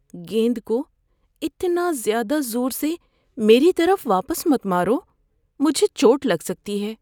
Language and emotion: Urdu, fearful